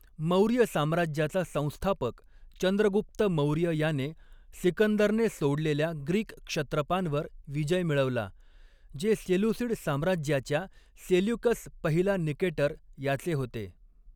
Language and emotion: Marathi, neutral